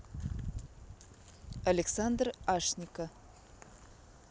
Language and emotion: Russian, neutral